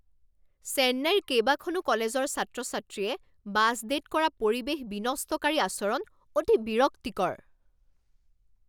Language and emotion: Assamese, angry